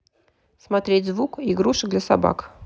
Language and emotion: Russian, neutral